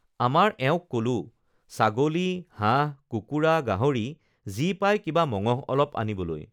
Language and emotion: Assamese, neutral